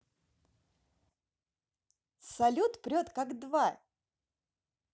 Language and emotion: Russian, positive